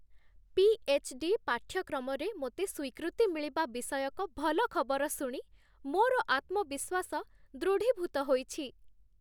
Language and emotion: Odia, happy